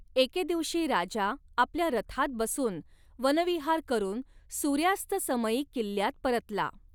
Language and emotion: Marathi, neutral